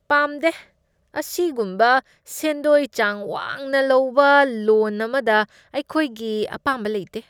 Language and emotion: Manipuri, disgusted